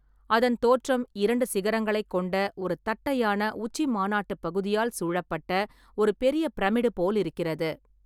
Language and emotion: Tamil, neutral